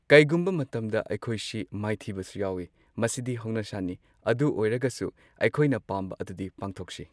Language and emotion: Manipuri, neutral